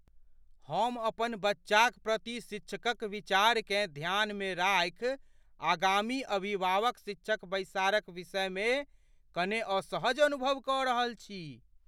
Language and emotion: Maithili, fearful